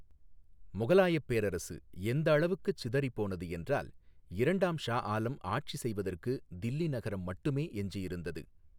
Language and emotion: Tamil, neutral